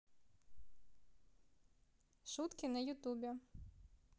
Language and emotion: Russian, positive